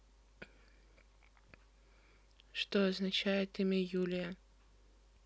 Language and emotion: Russian, neutral